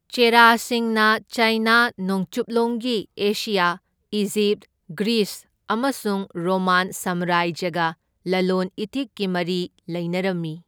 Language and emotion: Manipuri, neutral